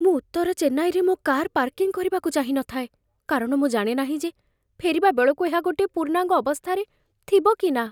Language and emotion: Odia, fearful